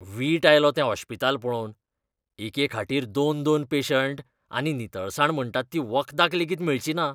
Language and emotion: Goan Konkani, disgusted